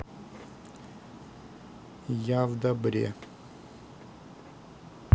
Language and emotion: Russian, neutral